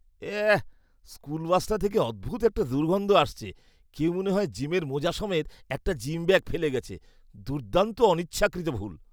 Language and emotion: Bengali, disgusted